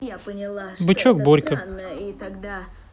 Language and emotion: Russian, neutral